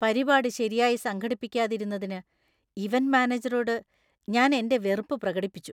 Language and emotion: Malayalam, disgusted